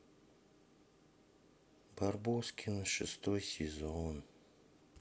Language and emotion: Russian, sad